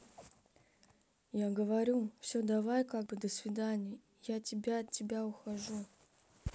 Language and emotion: Russian, sad